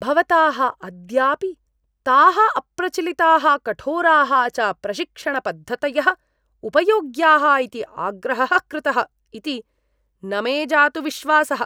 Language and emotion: Sanskrit, disgusted